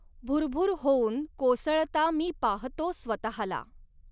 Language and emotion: Marathi, neutral